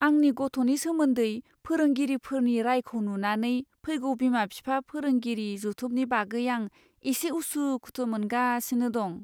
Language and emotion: Bodo, fearful